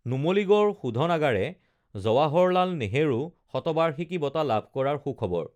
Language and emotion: Assamese, neutral